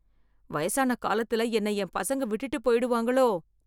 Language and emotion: Tamil, fearful